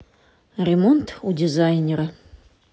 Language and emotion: Russian, neutral